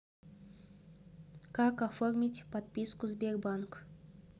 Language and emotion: Russian, neutral